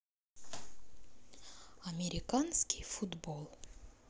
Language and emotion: Russian, sad